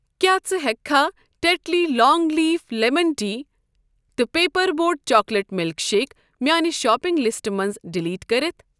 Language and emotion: Kashmiri, neutral